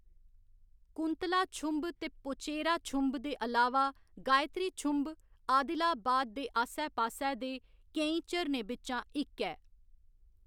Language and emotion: Dogri, neutral